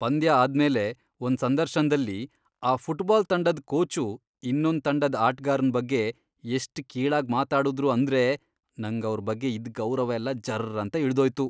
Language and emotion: Kannada, disgusted